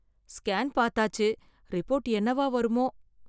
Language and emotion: Tamil, fearful